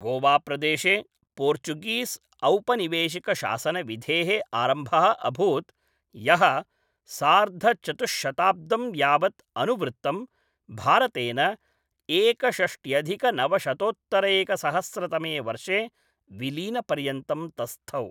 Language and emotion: Sanskrit, neutral